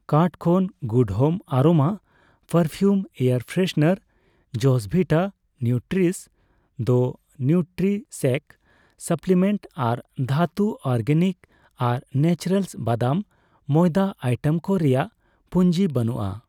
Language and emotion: Santali, neutral